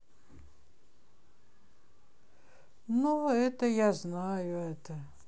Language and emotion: Russian, sad